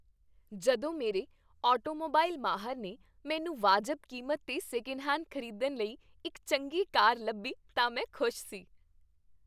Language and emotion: Punjabi, happy